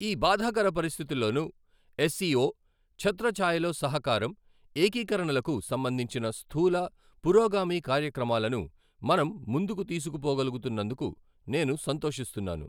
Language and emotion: Telugu, neutral